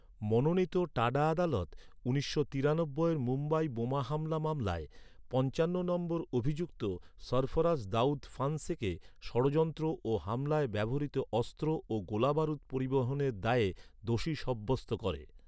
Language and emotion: Bengali, neutral